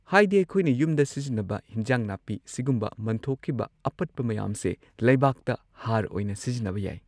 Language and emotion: Manipuri, neutral